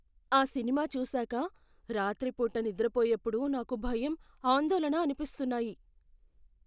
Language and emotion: Telugu, fearful